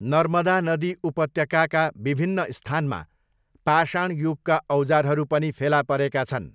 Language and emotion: Nepali, neutral